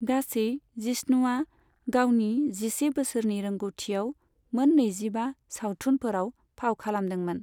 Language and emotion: Bodo, neutral